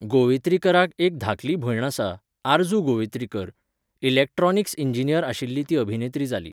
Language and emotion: Goan Konkani, neutral